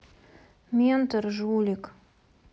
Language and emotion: Russian, sad